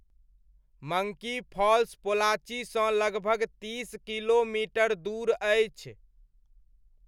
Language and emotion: Maithili, neutral